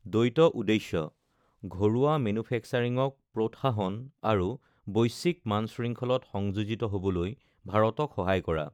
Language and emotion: Assamese, neutral